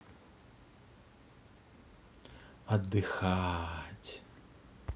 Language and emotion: Russian, positive